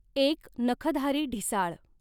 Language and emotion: Marathi, neutral